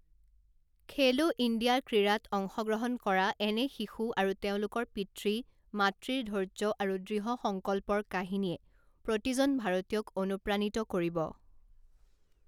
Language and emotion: Assamese, neutral